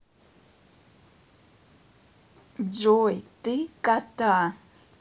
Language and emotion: Russian, neutral